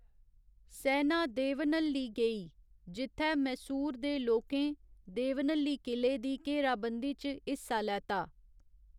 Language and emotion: Dogri, neutral